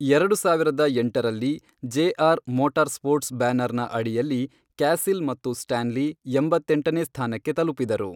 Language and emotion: Kannada, neutral